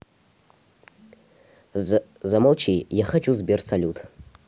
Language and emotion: Russian, neutral